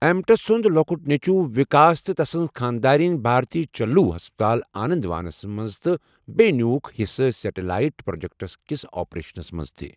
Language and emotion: Kashmiri, neutral